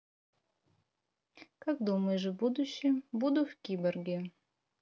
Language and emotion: Russian, neutral